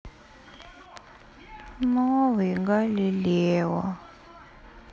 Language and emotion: Russian, sad